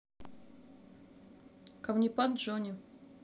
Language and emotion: Russian, neutral